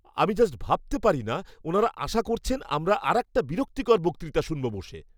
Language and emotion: Bengali, disgusted